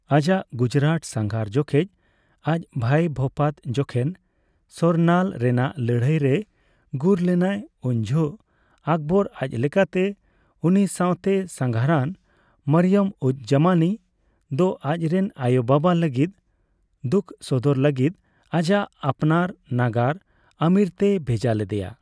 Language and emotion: Santali, neutral